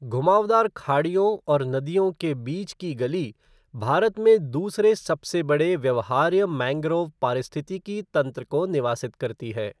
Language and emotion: Hindi, neutral